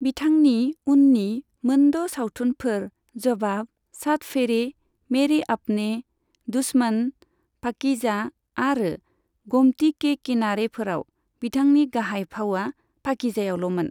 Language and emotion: Bodo, neutral